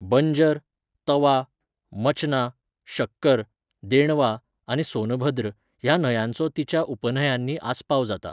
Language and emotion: Goan Konkani, neutral